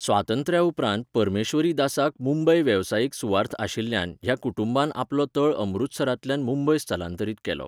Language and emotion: Goan Konkani, neutral